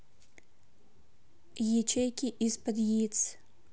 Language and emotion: Russian, neutral